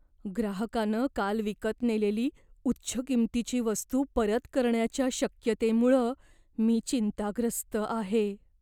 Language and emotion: Marathi, fearful